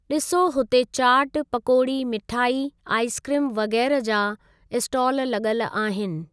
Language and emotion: Sindhi, neutral